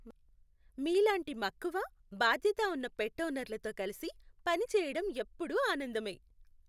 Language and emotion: Telugu, happy